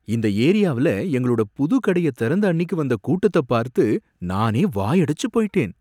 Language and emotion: Tamil, surprised